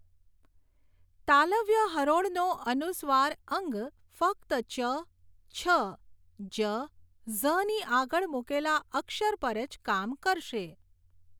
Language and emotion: Gujarati, neutral